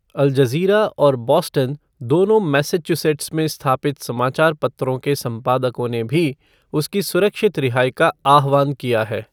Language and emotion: Hindi, neutral